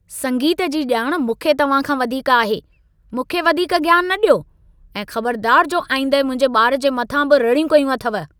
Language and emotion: Sindhi, angry